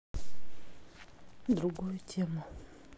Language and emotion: Russian, neutral